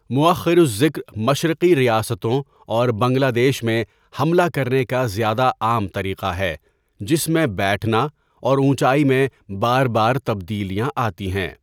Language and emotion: Urdu, neutral